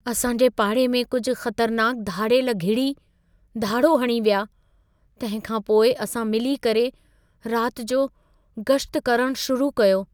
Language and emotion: Sindhi, fearful